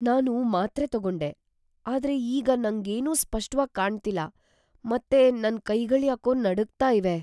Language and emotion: Kannada, fearful